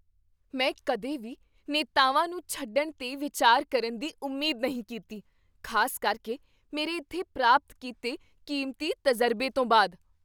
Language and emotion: Punjabi, surprised